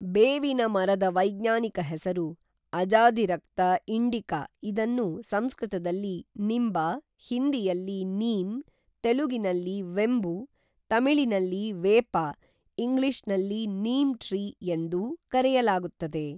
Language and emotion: Kannada, neutral